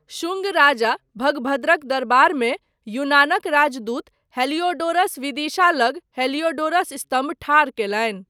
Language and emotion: Maithili, neutral